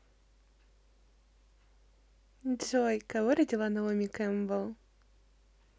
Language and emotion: Russian, positive